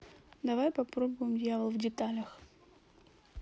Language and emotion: Russian, neutral